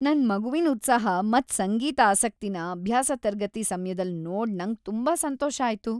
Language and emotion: Kannada, happy